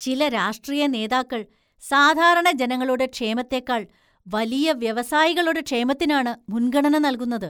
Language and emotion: Malayalam, disgusted